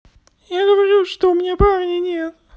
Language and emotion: Russian, sad